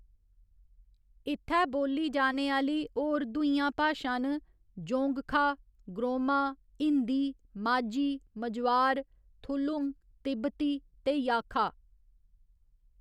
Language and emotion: Dogri, neutral